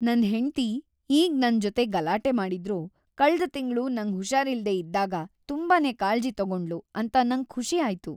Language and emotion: Kannada, happy